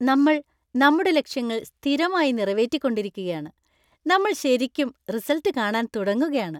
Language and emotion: Malayalam, happy